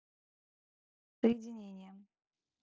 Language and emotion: Russian, neutral